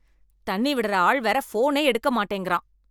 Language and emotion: Tamil, angry